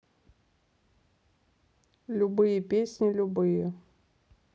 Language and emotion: Russian, neutral